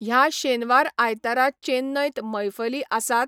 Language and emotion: Goan Konkani, neutral